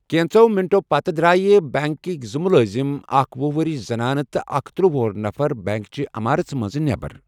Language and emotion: Kashmiri, neutral